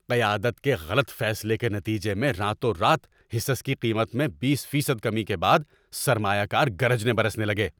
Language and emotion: Urdu, angry